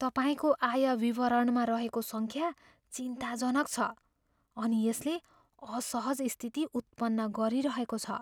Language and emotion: Nepali, fearful